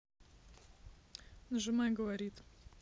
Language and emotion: Russian, neutral